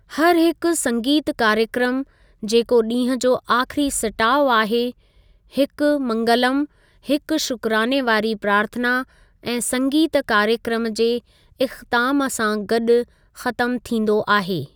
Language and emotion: Sindhi, neutral